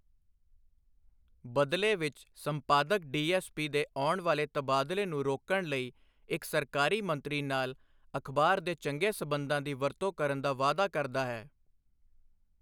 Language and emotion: Punjabi, neutral